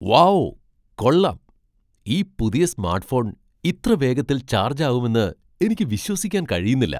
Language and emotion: Malayalam, surprised